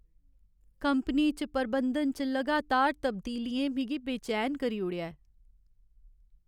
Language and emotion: Dogri, sad